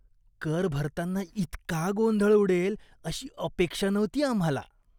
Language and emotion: Marathi, disgusted